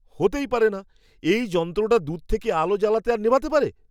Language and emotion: Bengali, surprised